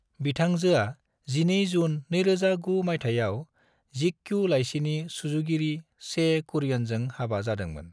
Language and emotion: Bodo, neutral